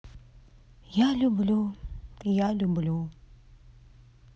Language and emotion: Russian, sad